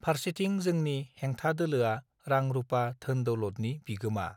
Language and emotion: Bodo, neutral